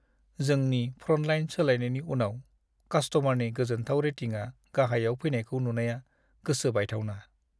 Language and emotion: Bodo, sad